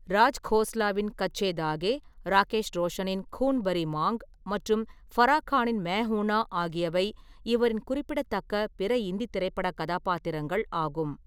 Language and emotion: Tamil, neutral